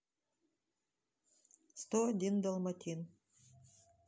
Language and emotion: Russian, neutral